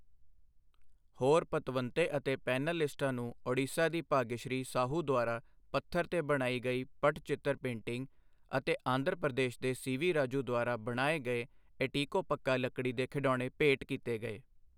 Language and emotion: Punjabi, neutral